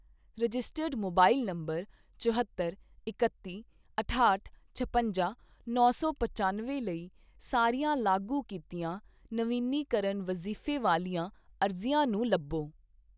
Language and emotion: Punjabi, neutral